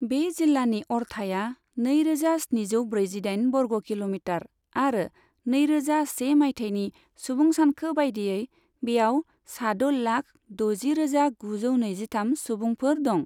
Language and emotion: Bodo, neutral